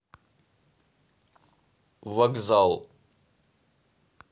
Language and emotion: Russian, neutral